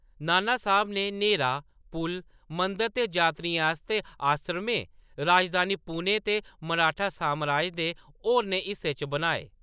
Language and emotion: Dogri, neutral